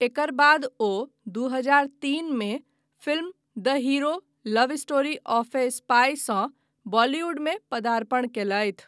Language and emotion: Maithili, neutral